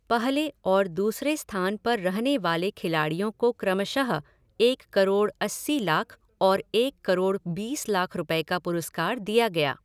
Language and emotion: Hindi, neutral